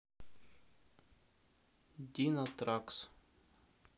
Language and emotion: Russian, neutral